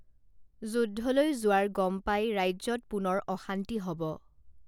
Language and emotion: Assamese, neutral